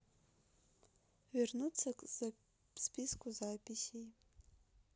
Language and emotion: Russian, neutral